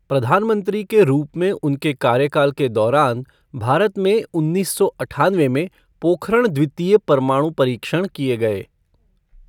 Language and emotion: Hindi, neutral